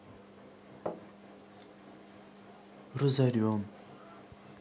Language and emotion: Russian, sad